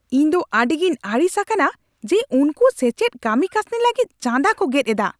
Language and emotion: Santali, angry